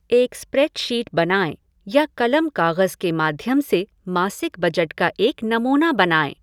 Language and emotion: Hindi, neutral